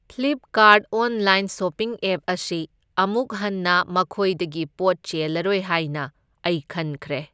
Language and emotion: Manipuri, neutral